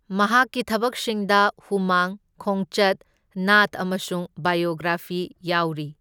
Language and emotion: Manipuri, neutral